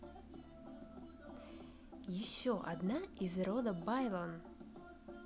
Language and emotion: Russian, neutral